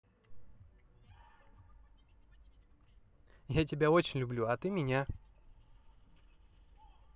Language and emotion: Russian, positive